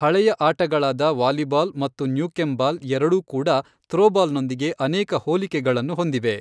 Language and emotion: Kannada, neutral